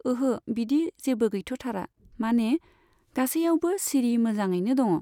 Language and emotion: Bodo, neutral